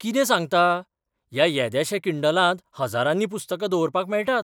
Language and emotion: Goan Konkani, surprised